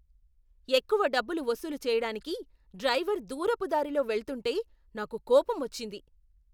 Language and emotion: Telugu, angry